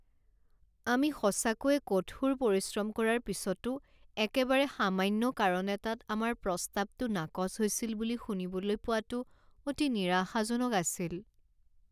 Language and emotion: Assamese, sad